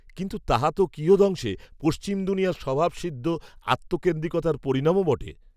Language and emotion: Bengali, neutral